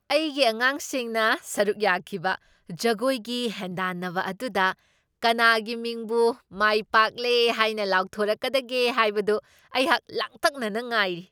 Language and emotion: Manipuri, surprised